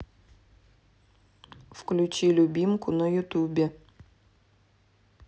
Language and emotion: Russian, neutral